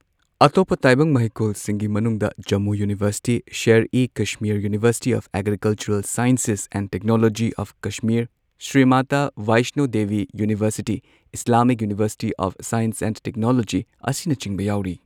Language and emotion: Manipuri, neutral